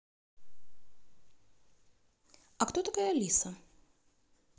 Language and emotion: Russian, neutral